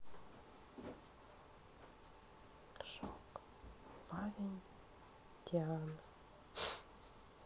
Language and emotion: Russian, sad